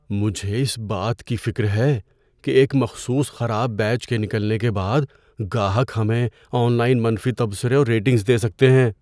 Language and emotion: Urdu, fearful